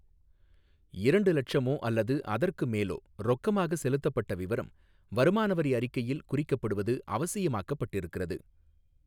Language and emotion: Tamil, neutral